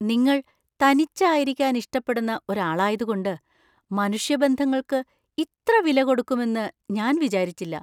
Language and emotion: Malayalam, surprised